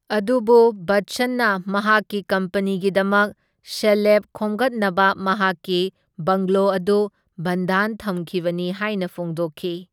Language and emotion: Manipuri, neutral